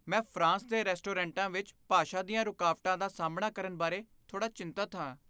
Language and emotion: Punjabi, fearful